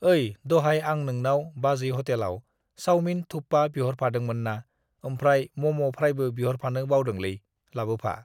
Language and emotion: Bodo, neutral